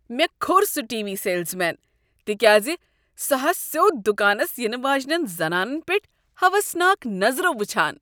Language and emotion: Kashmiri, disgusted